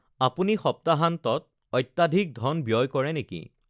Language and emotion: Assamese, neutral